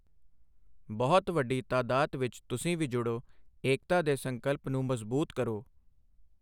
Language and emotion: Punjabi, neutral